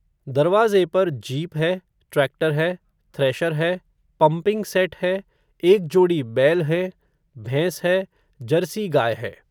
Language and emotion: Hindi, neutral